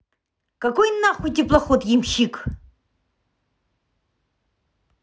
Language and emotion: Russian, angry